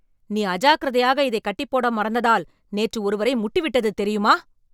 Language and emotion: Tamil, angry